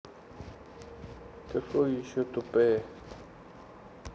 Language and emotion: Russian, sad